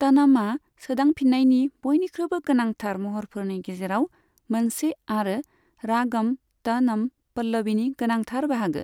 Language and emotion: Bodo, neutral